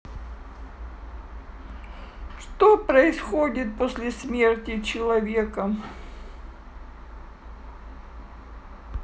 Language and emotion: Russian, sad